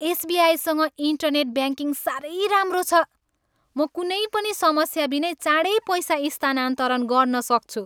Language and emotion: Nepali, happy